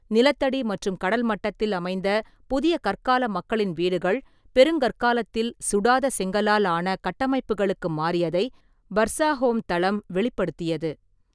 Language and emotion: Tamil, neutral